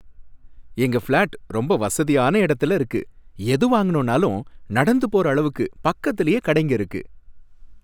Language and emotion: Tamil, happy